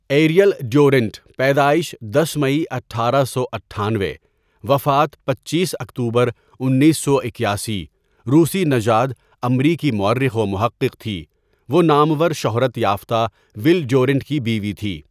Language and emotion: Urdu, neutral